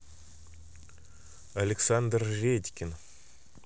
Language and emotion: Russian, neutral